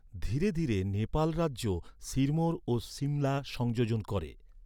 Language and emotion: Bengali, neutral